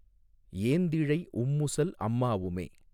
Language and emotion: Tamil, neutral